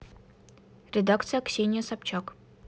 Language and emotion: Russian, neutral